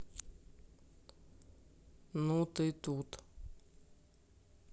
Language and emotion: Russian, angry